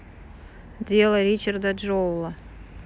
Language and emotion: Russian, neutral